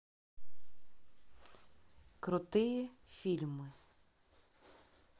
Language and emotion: Russian, neutral